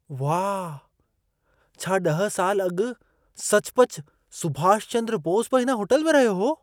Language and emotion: Sindhi, surprised